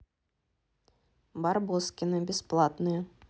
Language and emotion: Russian, neutral